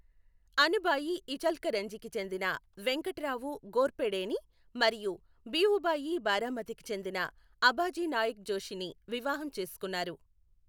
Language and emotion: Telugu, neutral